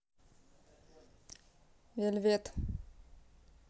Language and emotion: Russian, neutral